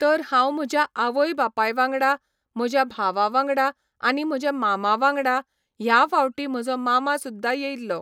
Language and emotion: Goan Konkani, neutral